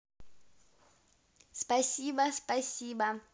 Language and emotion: Russian, positive